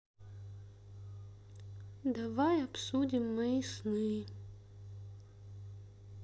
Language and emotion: Russian, sad